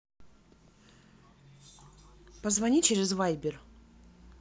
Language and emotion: Russian, neutral